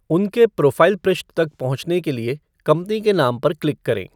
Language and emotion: Hindi, neutral